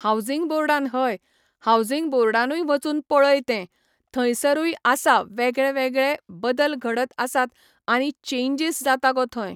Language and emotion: Goan Konkani, neutral